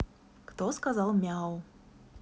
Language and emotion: Russian, neutral